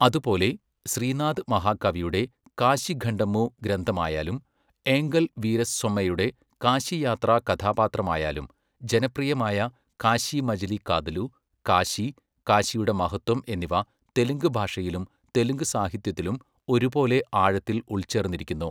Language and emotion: Malayalam, neutral